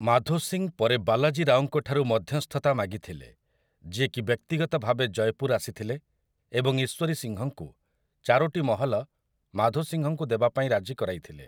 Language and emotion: Odia, neutral